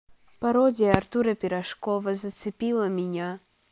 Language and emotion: Russian, neutral